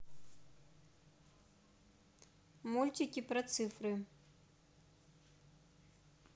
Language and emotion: Russian, neutral